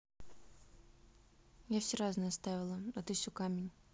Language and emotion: Russian, neutral